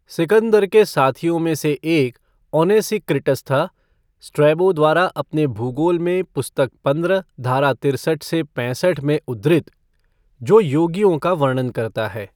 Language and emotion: Hindi, neutral